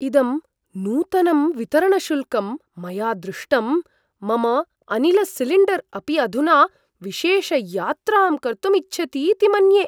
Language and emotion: Sanskrit, surprised